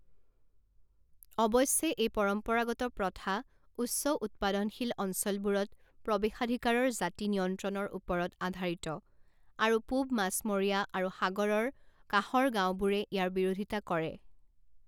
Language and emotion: Assamese, neutral